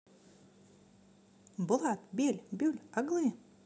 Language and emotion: Russian, positive